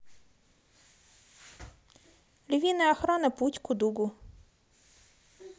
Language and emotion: Russian, neutral